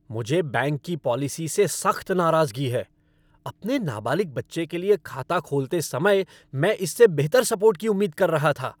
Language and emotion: Hindi, angry